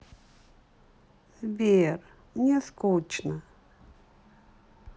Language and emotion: Russian, sad